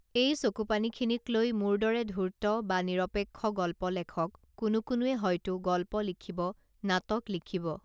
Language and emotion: Assamese, neutral